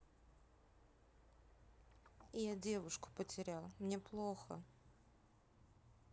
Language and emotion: Russian, sad